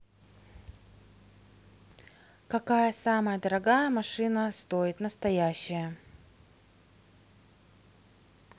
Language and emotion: Russian, neutral